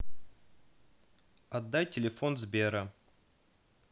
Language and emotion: Russian, neutral